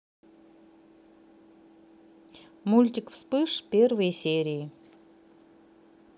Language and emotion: Russian, neutral